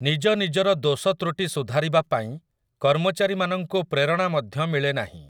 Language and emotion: Odia, neutral